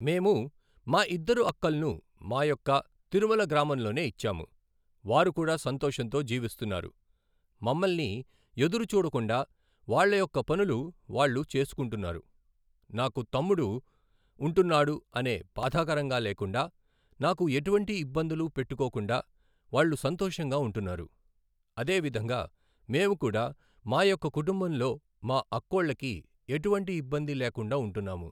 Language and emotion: Telugu, neutral